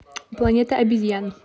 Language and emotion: Russian, neutral